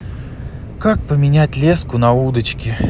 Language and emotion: Russian, sad